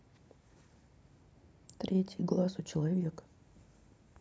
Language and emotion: Russian, neutral